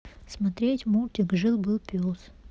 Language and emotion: Russian, neutral